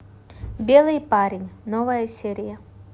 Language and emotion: Russian, neutral